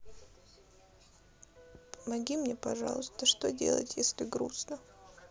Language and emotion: Russian, sad